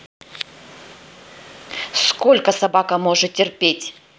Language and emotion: Russian, angry